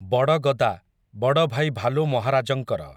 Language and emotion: Odia, neutral